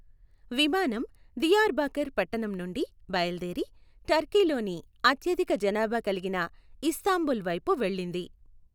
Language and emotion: Telugu, neutral